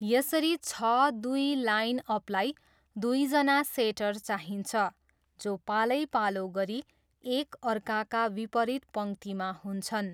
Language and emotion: Nepali, neutral